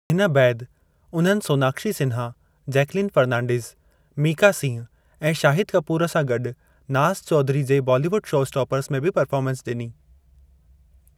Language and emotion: Sindhi, neutral